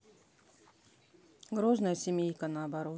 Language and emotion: Russian, neutral